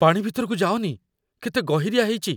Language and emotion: Odia, fearful